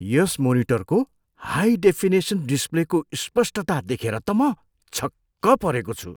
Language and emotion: Nepali, surprised